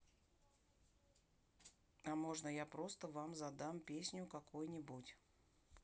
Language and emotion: Russian, neutral